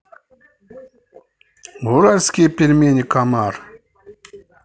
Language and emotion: Russian, neutral